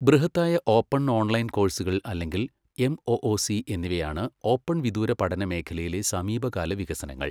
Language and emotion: Malayalam, neutral